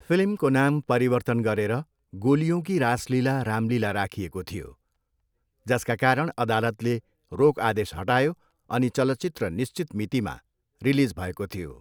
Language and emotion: Nepali, neutral